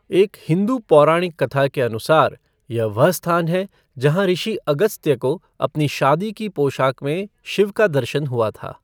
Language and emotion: Hindi, neutral